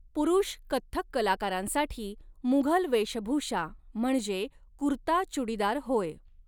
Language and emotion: Marathi, neutral